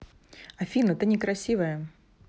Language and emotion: Russian, neutral